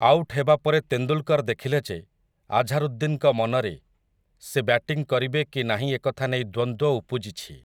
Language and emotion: Odia, neutral